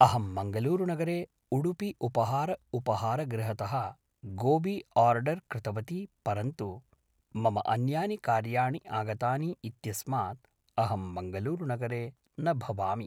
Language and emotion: Sanskrit, neutral